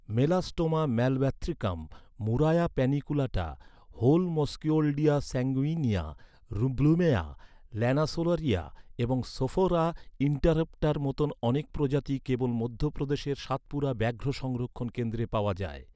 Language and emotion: Bengali, neutral